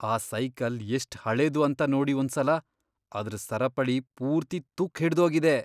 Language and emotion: Kannada, disgusted